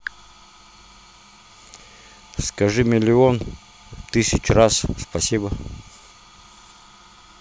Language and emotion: Russian, neutral